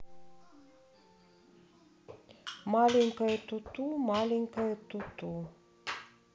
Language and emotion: Russian, neutral